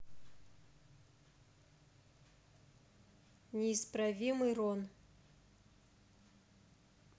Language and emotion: Russian, neutral